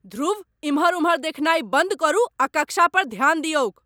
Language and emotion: Maithili, angry